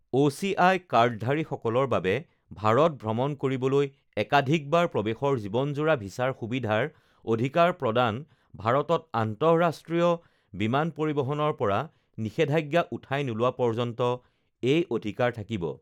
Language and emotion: Assamese, neutral